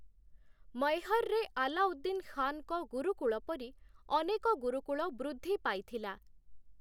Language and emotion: Odia, neutral